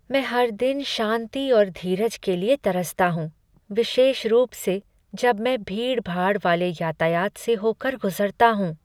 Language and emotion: Hindi, sad